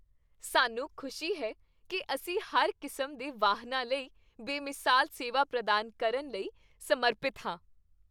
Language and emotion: Punjabi, happy